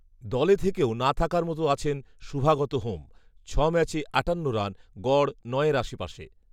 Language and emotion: Bengali, neutral